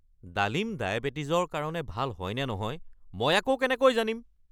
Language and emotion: Assamese, angry